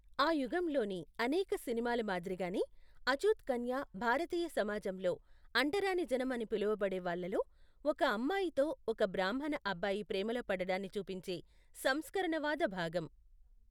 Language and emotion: Telugu, neutral